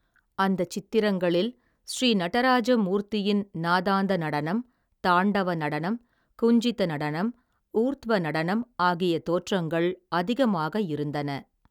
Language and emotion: Tamil, neutral